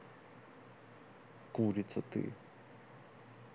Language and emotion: Russian, neutral